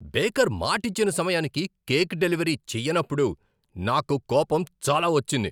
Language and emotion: Telugu, angry